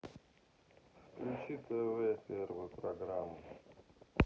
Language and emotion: Russian, sad